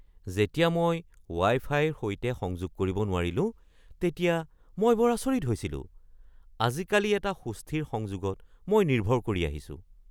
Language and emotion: Assamese, surprised